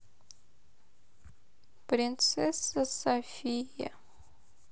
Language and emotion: Russian, sad